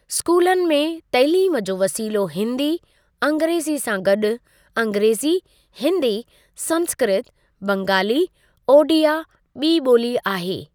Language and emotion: Sindhi, neutral